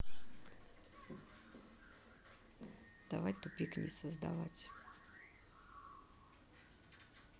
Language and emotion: Russian, neutral